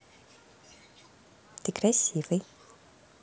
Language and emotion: Russian, positive